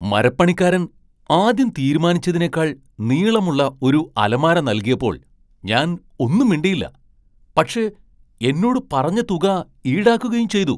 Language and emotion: Malayalam, surprised